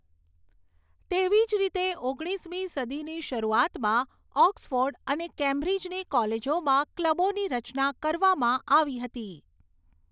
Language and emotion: Gujarati, neutral